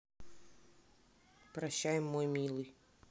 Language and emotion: Russian, sad